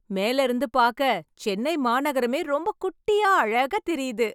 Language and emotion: Tamil, happy